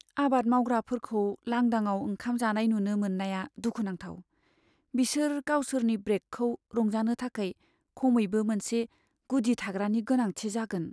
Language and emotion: Bodo, sad